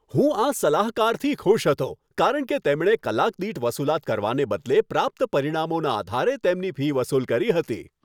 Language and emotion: Gujarati, happy